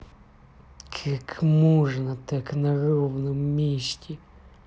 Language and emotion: Russian, angry